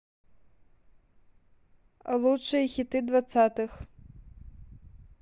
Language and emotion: Russian, neutral